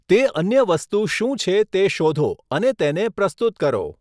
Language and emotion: Gujarati, neutral